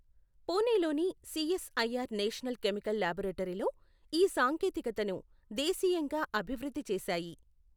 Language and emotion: Telugu, neutral